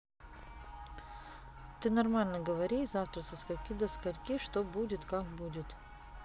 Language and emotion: Russian, neutral